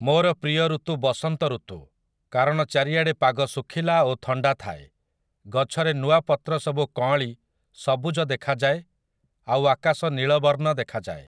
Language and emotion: Odia, neutral